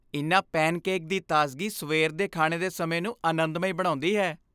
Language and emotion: Punjabi, happy